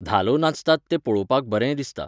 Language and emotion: Goan Konkani, neutral